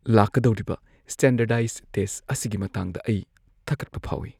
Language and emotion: Manipuri, fearful